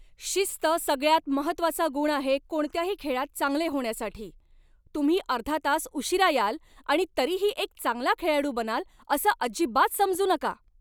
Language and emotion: Marathi, angry